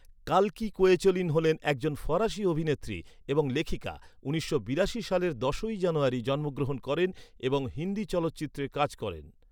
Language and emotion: Bengali, neutral